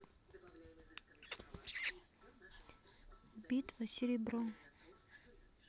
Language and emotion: Russian, neutral